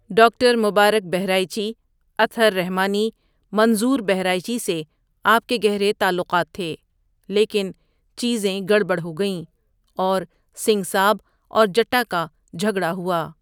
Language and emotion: Urdu, neutral